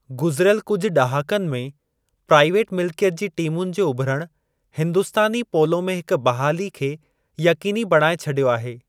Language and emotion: Sindhi, neutral